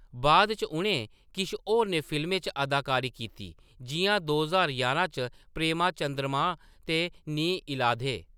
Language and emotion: Dogri, neutral